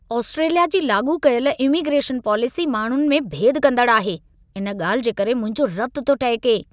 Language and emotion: Sindhi, angry